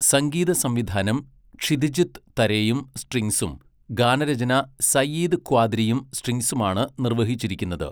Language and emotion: Malayalam, neutral